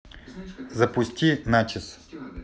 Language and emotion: Russian, neutral